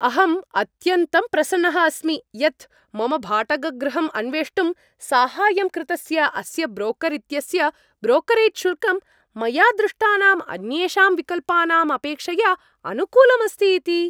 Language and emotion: Sanskrit, happy